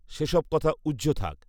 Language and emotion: Bengali, neutral